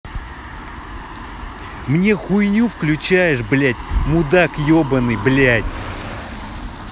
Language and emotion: Russian, angry